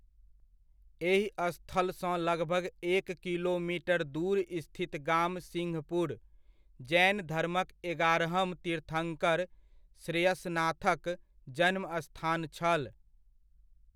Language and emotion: Maithili, neutral